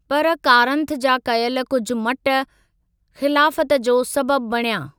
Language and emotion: Sindhi, neutral